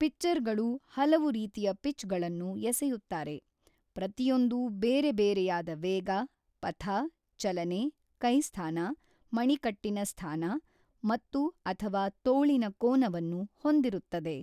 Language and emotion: Kannada, neutral